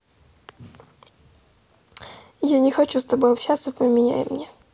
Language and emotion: Russian, sad